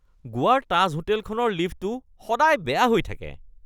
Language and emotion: Assamese, disgusted